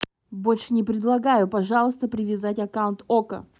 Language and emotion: Russian, angry